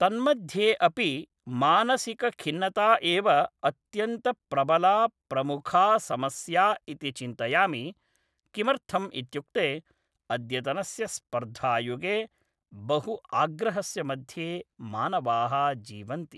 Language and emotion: Sanskrit, neutral